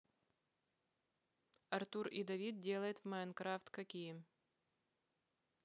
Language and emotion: Russian, neutral